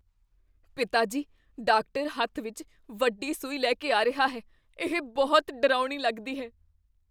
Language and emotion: Punjabi, fearful